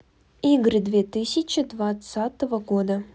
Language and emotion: Russian, neutral